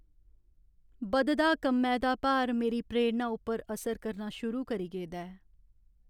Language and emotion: Dogri, sad